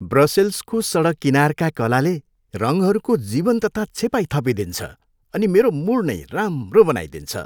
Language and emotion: Nepali, happy